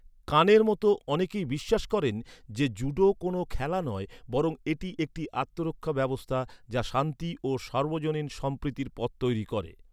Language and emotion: Bengali, neutral